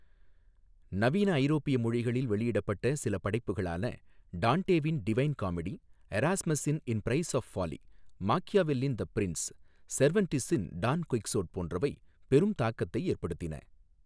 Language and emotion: Tamil, neutral